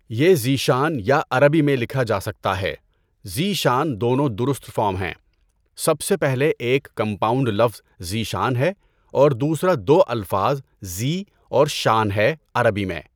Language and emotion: Urdu, neutral